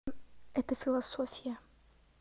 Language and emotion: Russian, neutral